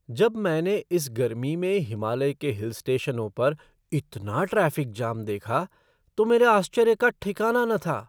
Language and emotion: Hindi, surprised